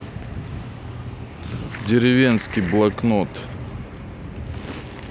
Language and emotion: Russian, neutral